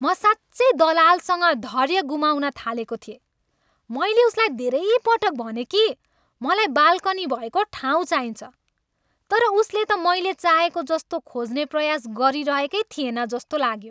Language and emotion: Nepali, angry